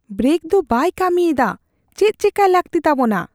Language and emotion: Santali, fearful